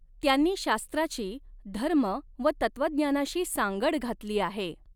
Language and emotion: Marathi, neutral